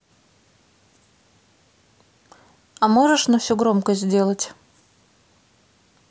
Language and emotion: Russian, neutral